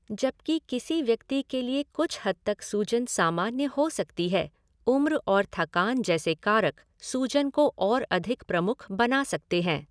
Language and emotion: Hindi, neutral